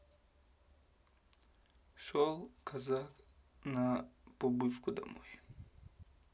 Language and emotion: Russian, neutral